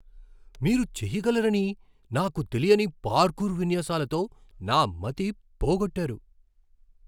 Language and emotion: Telugu, surprised